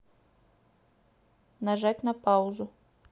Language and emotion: Russian, neutral